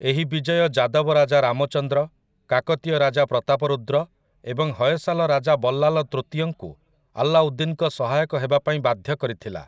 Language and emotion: Odia, neutral